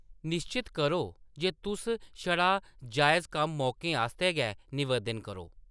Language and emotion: Dogri, neutral